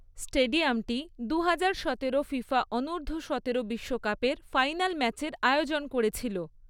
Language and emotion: Bengali, neutral